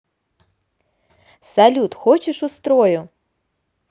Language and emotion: Russian, positive